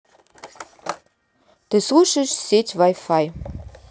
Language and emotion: Russian, neutral